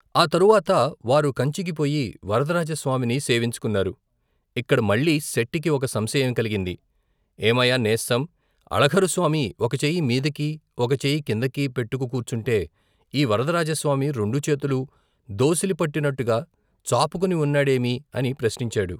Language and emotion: Telugu, neutral